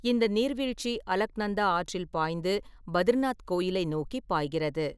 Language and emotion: Tamil, neutral